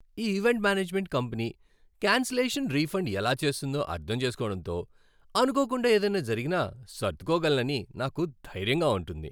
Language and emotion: Telugu, happy